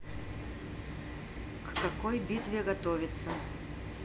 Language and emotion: Russian, neutral